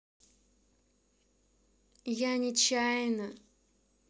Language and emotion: Russian, sad